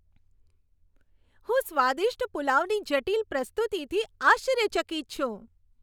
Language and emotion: Gujarati, happy